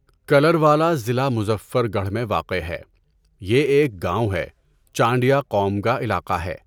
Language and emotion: Urdu, neutral